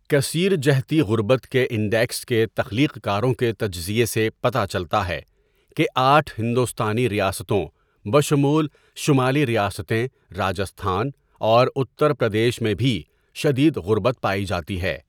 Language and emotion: Urdu, neutral